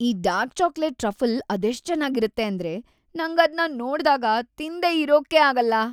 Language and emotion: Kannada, happy